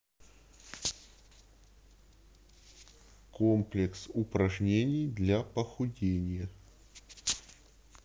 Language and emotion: Russian, neutral